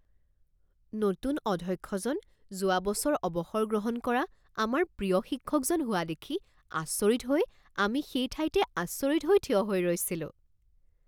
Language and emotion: Assamese, surprised